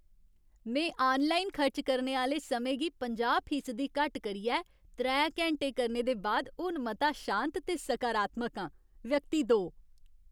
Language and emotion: Dogri, happy